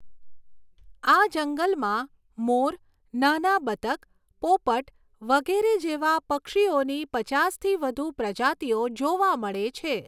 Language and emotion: Gujarati, neutral